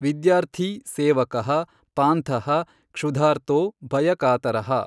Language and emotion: Kannada, neutral